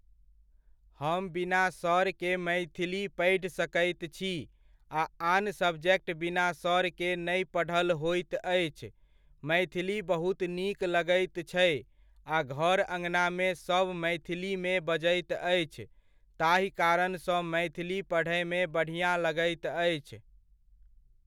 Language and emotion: Maithili, neutral